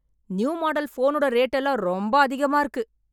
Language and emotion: Tamil, angry